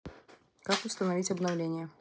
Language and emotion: Russian, neutral